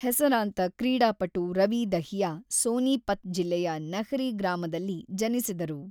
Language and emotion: Kannada, neutral